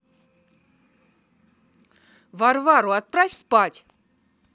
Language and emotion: Russian, angry